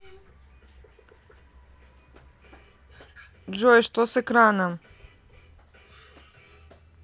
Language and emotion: Russian, neutral